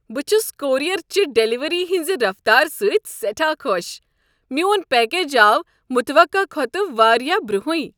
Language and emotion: Kashmiri, happy